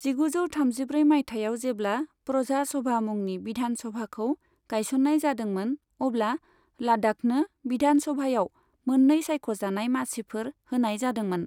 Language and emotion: Bodo, neutral